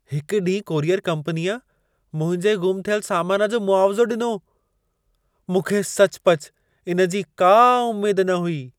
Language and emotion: Sindhi, surprised